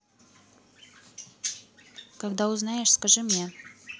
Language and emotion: Russian, neutral